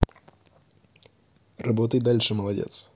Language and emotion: Russian, positive